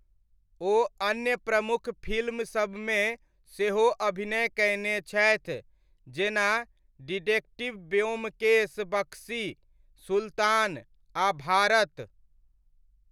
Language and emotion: Maithili, neutral